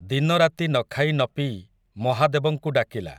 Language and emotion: Odia, neutral